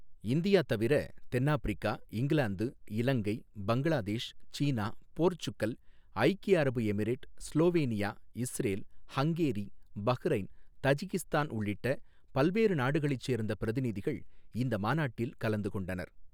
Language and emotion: Tamil, neutral